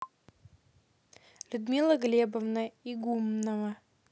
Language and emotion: Russian, neutral